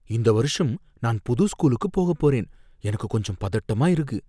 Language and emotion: Tamil, fearful